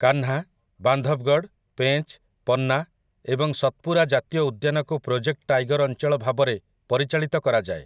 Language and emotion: Odia, neutral